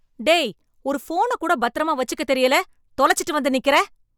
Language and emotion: Tamil, angry